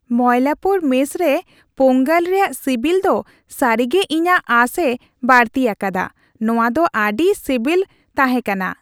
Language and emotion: Santali, happy